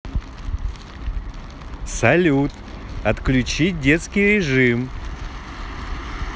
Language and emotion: Russian, positive